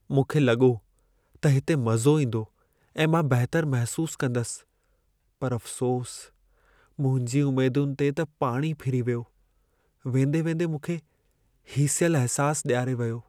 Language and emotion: Sindhi, sad